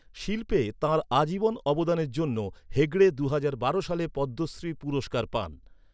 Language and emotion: Bengali, neutral